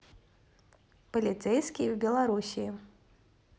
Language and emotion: Russian, neutral